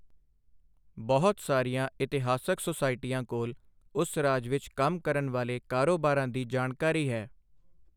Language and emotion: Punjabi, neutral